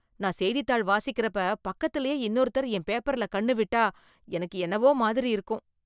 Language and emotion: Tamil, disgusted